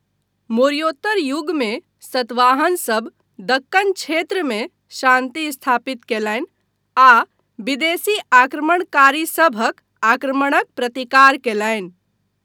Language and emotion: Maithili, neutral